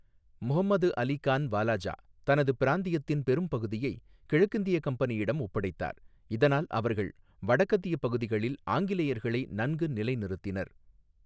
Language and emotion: Tamil, neutral